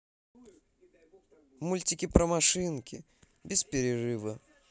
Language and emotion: Russian, positive